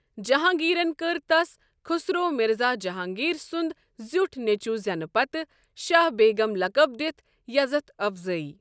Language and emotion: Kashmiri, neutral